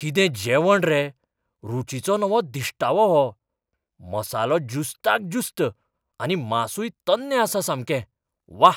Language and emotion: Goan Konkani, surprised